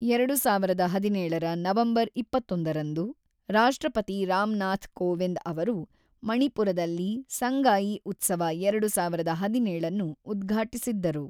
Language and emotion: Kannada, neutral